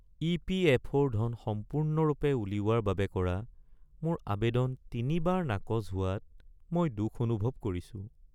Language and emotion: Assamese, sad